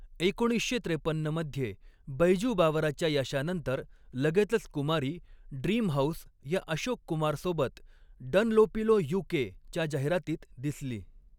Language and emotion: Marathi, neutral